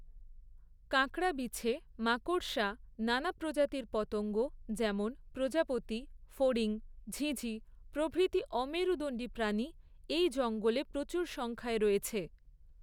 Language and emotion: Bengali, neutral